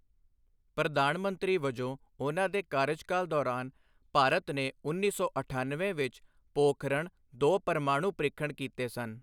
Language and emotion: Punjabi, neutral